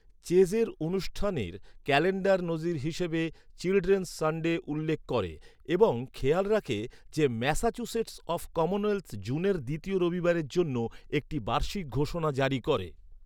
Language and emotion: Bengali, neutral